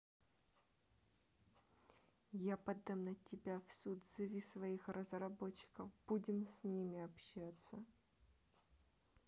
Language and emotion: Russian, neutral